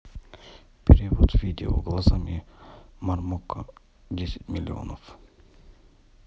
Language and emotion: Russian, neutral